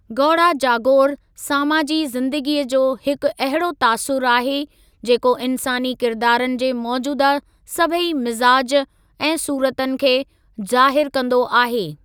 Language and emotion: Sindhi, neutral